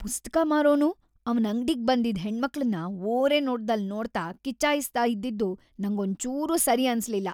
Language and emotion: Kannada, disgusted